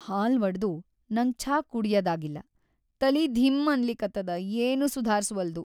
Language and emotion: Kannada, sad